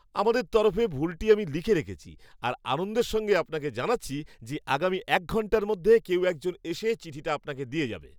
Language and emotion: Bengali, happy